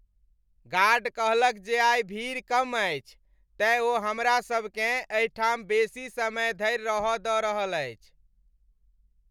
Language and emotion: Maithili, happy